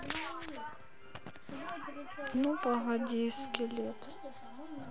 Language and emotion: Russian, sad